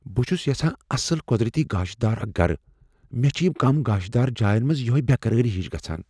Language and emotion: Kashmiri, fearful